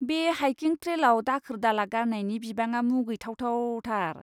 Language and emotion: Bodo, disgusted